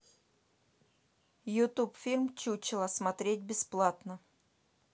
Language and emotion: Russian, neutral